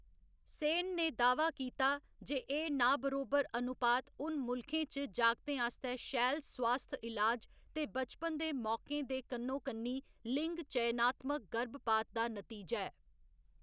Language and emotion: Dogri, neutral